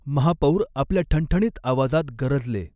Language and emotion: Marathi, neutral